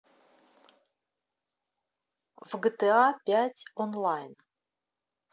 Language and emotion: Russian, neutral